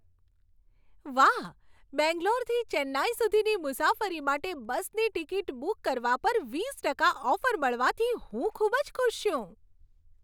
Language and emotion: Gujarati, happy